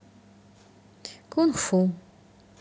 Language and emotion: Russian, neutral